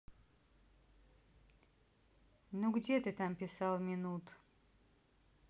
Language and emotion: Russian, neutral